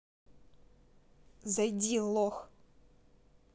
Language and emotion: Russian, angry